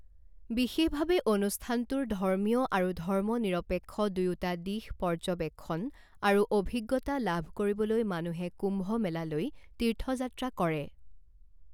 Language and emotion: Assamese, neutral